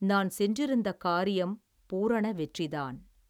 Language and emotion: Tamil, neutral